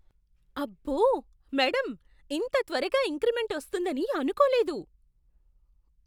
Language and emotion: Telugu, surprised